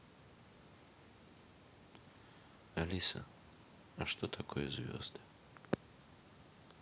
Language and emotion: Russian, neutral